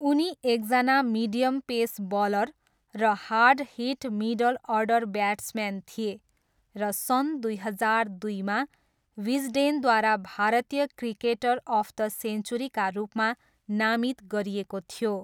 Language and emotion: Nepali, neutral